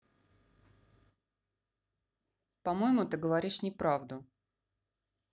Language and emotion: Russian, neutral